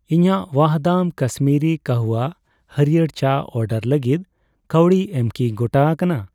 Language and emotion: Santali, neutral